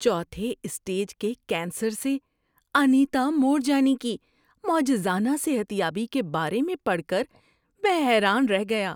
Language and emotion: Urdu, surprised